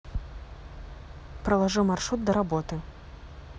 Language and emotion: Russian, neutral